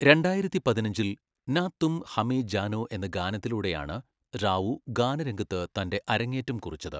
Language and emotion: Malayalam, neutral